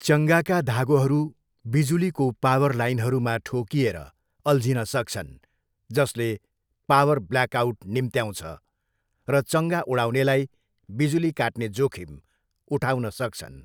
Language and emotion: Nepali, neutral